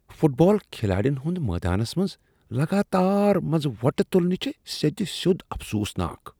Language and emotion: Kashmiri, disgusted